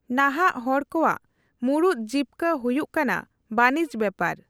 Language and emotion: Santali, neutral